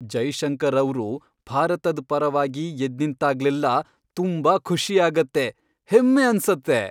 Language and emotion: Kannada, happy